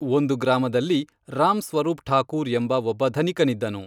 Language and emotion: Kannada, neutral